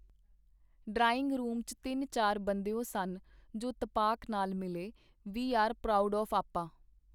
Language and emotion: Punjabi, neutral